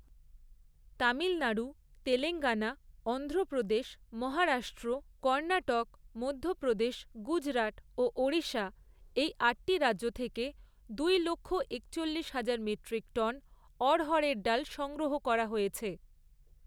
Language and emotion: Bengali, neutral